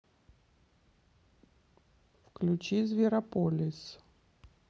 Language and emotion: Russian, neutral